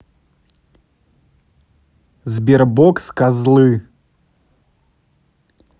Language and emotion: Russian, angry